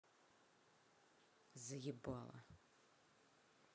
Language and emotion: Russian, angry